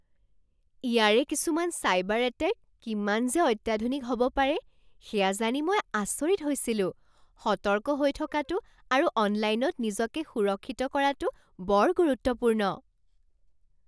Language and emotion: Assamese, surprised